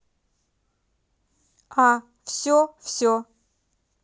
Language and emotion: Russian, neutral